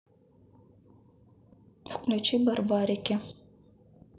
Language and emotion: Russian, neutral